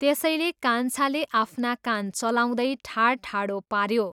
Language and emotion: Nepali, neutral